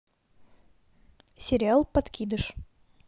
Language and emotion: Russian, neutral